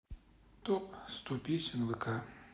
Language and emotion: Russian, sad